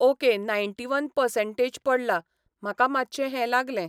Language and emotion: Goan Konkani, neutral